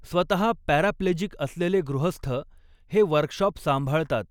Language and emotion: Marathi, neutral